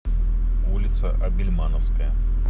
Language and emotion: Russian, neutral